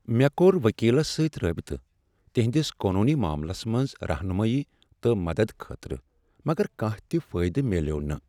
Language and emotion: Kashmiri, sad